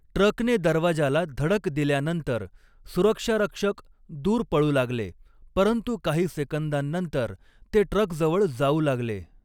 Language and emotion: Marathi, neutral